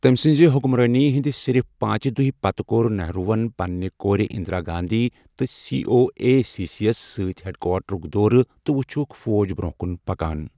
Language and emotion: Kashmiri, neutral